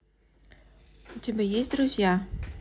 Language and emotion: Russian, neutral